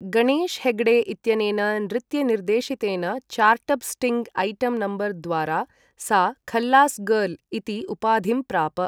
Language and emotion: Sanskrit, neutral